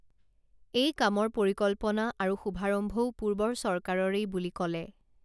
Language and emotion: Assamese, neutral